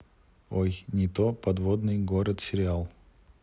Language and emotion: Russian, neutral